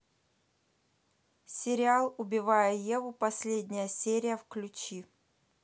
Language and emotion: Russian, neutral